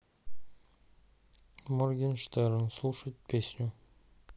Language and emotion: Russian, neutral